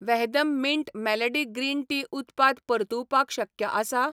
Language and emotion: Goan Konkani, neutral